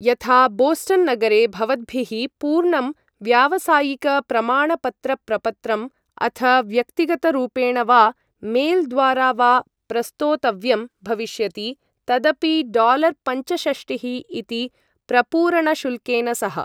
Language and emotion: Sanskrit, neutral